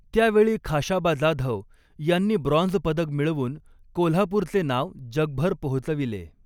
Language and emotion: Marathi, neutral